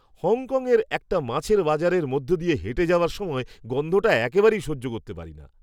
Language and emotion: Bengali, disgusted